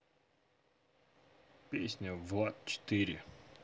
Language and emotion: Russian, neutral